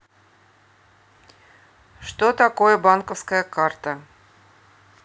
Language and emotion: Russian, neutral